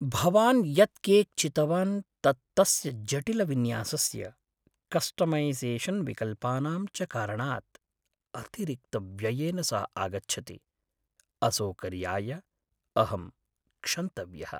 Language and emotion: Sanskrit, sad